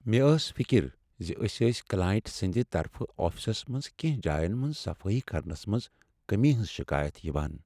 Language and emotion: Kashmiri, sad